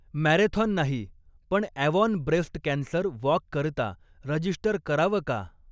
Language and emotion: Marathi, neutral